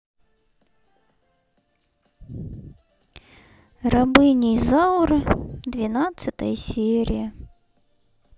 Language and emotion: Russian, sad